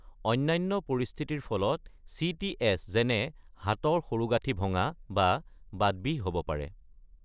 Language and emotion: Assamese, neutral